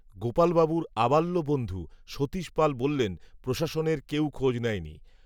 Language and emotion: Bengali, neutral